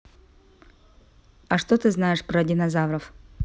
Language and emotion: Russian, neutral